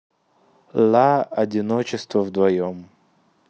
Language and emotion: Russian, neutral